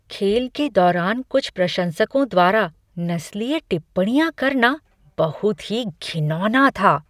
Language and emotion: Hindi, disgusted